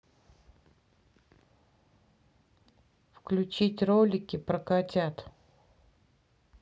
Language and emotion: Russian, neutral